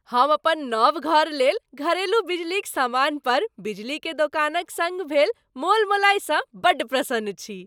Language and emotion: Maithili, happy